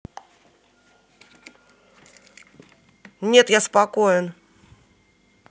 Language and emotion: Russian, angry